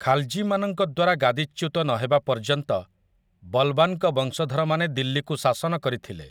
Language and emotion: Odia, neutral